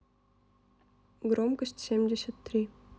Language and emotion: Russian, neutral